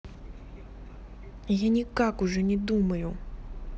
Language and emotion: Russian, angry